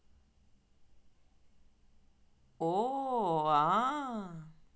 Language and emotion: Russian, positive